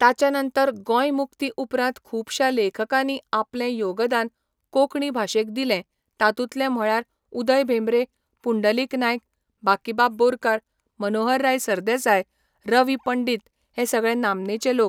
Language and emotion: Goan Konkani, neutral